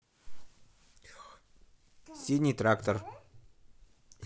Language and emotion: Russian, neutral